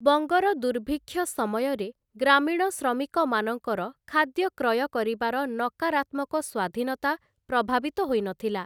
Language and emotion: Odia, neutral